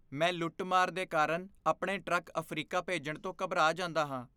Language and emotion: Punjabi, fearful